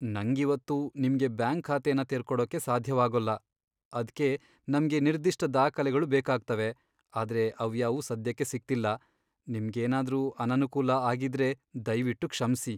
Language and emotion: Kannada, sad